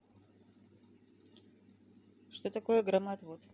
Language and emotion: Russian, neutral